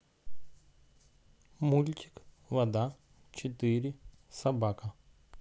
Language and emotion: Russian, neutral